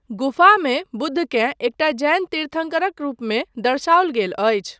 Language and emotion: Maithili, neutral